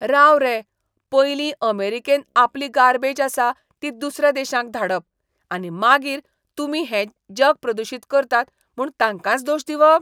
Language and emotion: Goan Konkani, disgusted